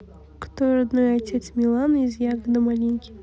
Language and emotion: Russian, neutral